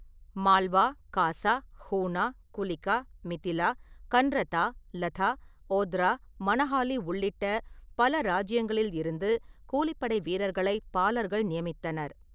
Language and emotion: Tamil, neutral